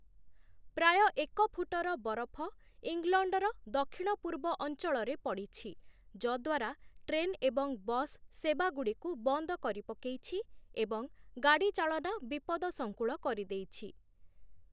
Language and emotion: Odia, neutral